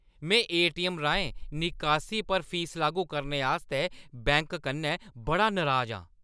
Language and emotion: Dogri, angry